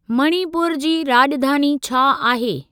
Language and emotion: Sindhi, neutral